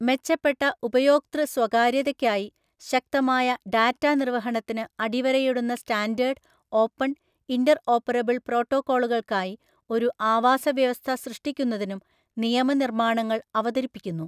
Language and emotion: Malayalam, neutral